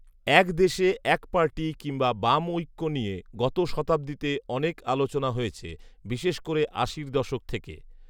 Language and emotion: Bengali, neutral